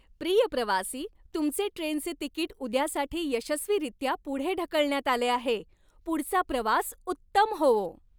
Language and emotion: Marathi, happy